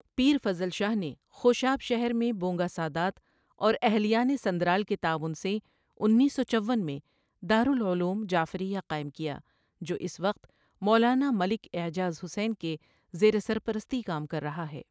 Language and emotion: Urdu, neutral